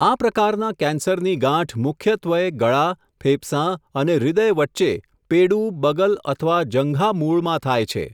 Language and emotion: Gujarati, neutral